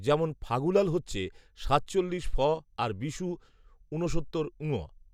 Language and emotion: Bengali, neutral